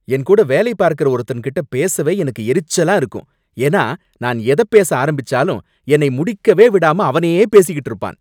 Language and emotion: Tamil, angry